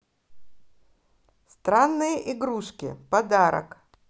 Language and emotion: Russian, positive